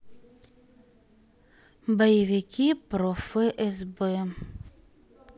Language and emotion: Russian, sad